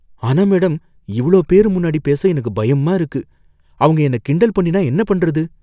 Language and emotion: Tamil, fearful